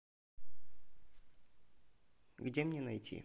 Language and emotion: Russian, neutral